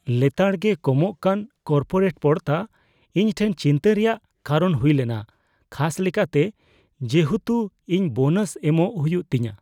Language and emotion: Santali, fearful